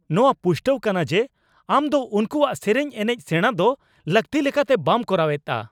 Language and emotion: Santali, angry